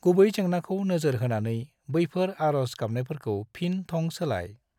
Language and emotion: Bodo, neutral